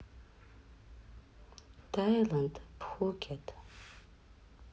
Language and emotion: Russian, neutral